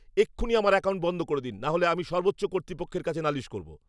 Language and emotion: Bengali, angry